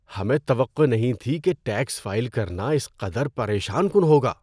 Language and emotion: Urdu, disgusted